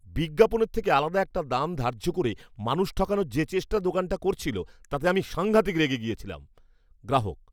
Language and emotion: Bengali, angry